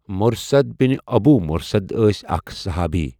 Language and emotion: Kashmiri, neutral